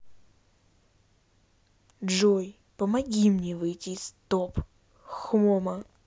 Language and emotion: Russian, neutral